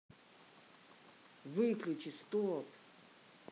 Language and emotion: Russian, angry